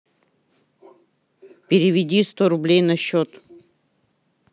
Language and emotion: Russian, angry